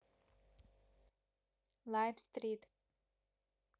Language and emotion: Russian, neutral